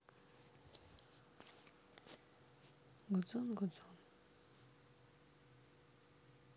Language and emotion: Russian, sad